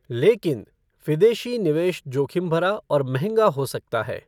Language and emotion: Hindi, neutral